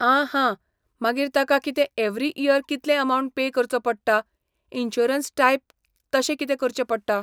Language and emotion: Goan Konkani, neutral